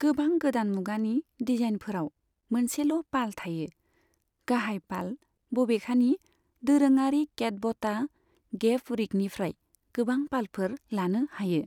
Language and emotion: Bodo, neutral